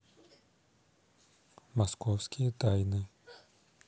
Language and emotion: Russian, neutral